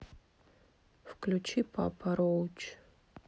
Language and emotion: Russian, neutral